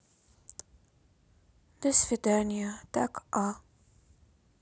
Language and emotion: Russian, sad